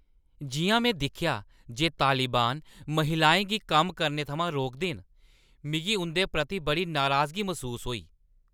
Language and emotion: Dogri, angry